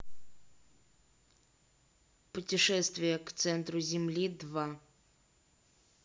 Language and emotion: Russian, neutral